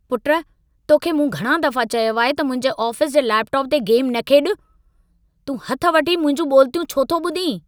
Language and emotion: Sindhi, angry